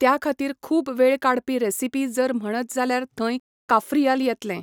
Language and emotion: Goan Konkani, neutral